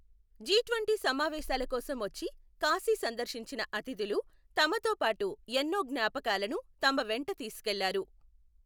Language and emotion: Telugu, neutral